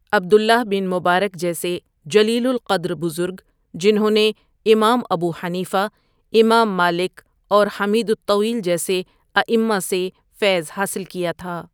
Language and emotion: Urdu, neutral